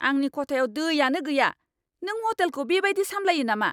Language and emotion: Bodo, angry